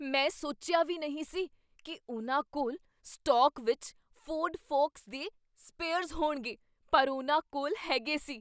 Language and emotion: Punjabi, surprised